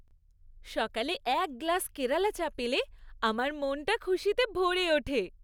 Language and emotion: Bengali, happy